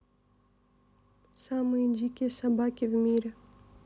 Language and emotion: Russian, neutral